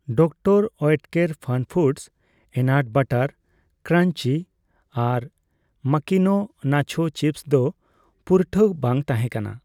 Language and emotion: Santali, neutral